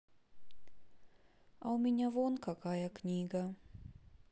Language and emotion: Russian, sad